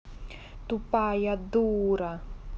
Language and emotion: Russian, neutral